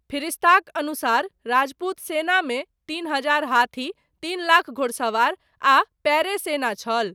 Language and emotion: Maithili, neutral